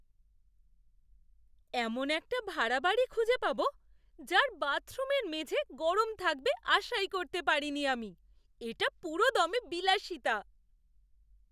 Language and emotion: Bengali, surprised